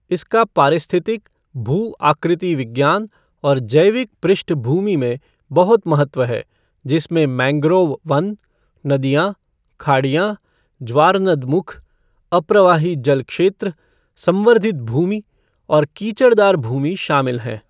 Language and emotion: Hindi, neutral